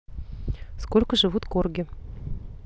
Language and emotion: Russian, neutral